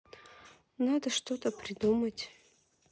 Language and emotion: Russian, neutral